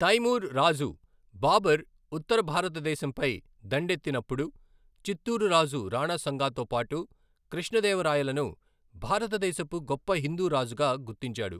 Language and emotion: Telugu, neutral